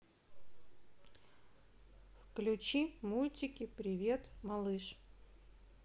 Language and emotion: Russian, neutral